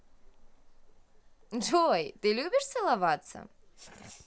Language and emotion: Russian, positive